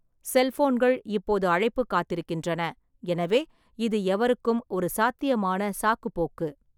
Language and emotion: Tamil, neutral